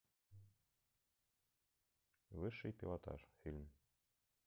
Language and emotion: Russian, neutral